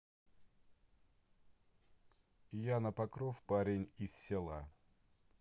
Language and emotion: Russian, neutral